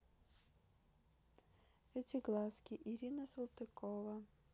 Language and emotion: Russian, neutral